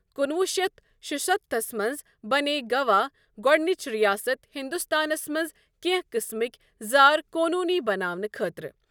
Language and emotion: Kashmiri, neutral